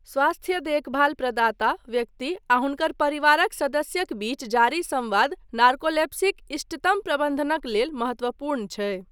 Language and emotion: Maithili, neutral